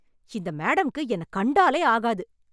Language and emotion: Tamil, angry